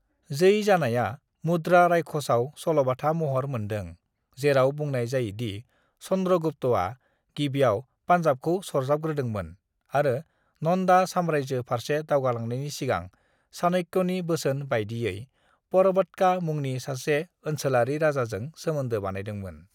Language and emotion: Bodo, neutral